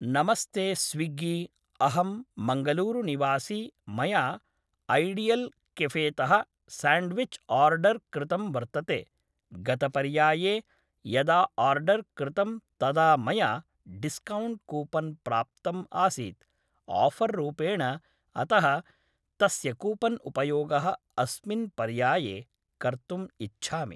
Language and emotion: Sanskrit, neutral